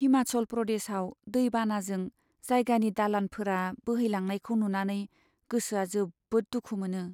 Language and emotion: Bodo, sad